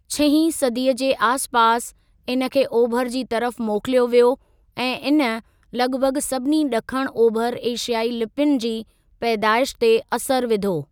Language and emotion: Sindhi, neutral